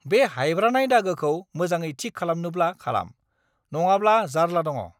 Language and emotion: Bodo, angry